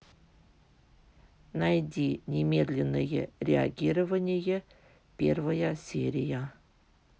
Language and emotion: Russian, neutral